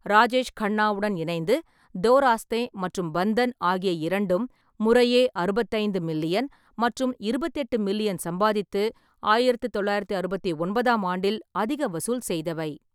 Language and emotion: Tamil, neutral